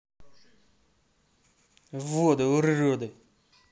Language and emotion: Russian, angry